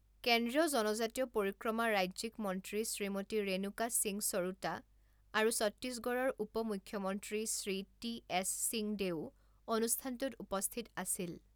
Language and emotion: Assamese, neutral